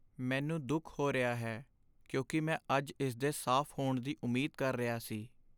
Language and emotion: Punjabi, sad